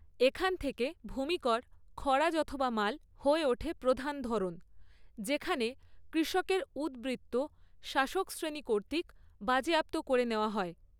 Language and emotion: Bengali, neutral